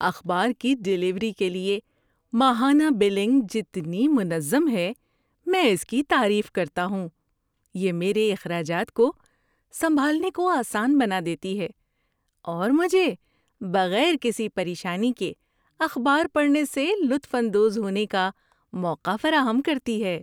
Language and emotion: Urdu, happy